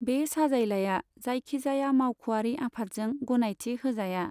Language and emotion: Bodo, neutral